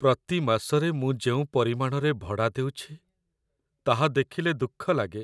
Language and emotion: Odia, sad